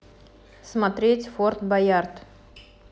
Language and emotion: Russian, neutral